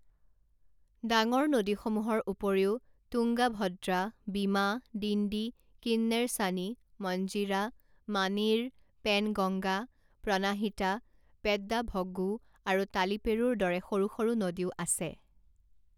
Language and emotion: Assamese, neutral